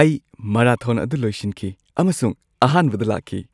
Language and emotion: Manipuri, happy